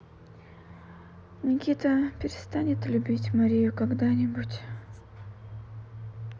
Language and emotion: Russian, sad